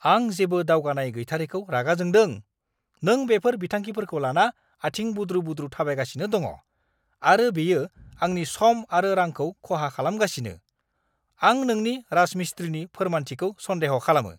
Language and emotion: Bodo, angry